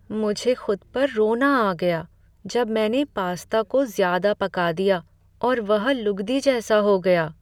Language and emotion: Hindi, sad